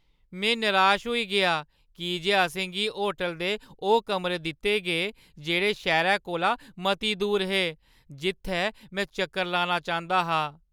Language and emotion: Dogri, sad